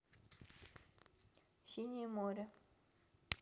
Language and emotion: Russian, neutral